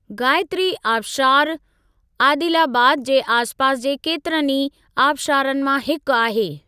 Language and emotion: Sindhi, neutral